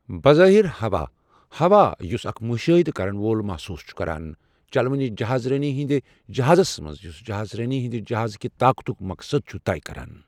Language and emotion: Kashmiri, neutral